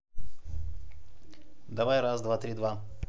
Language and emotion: Russian, neutral